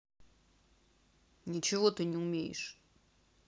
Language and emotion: Russian, angry